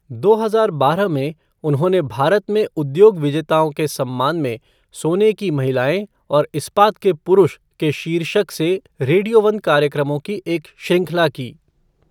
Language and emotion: Hindi, neutral